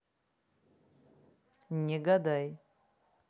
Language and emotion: Russian, neutral